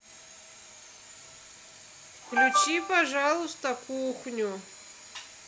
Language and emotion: Russian, positive